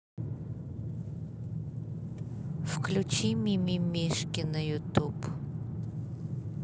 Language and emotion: Russian, neutral